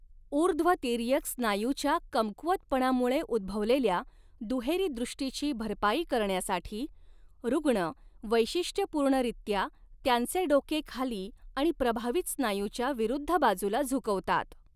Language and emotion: Marathi, neutral